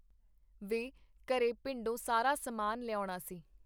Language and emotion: Punjabi, neutral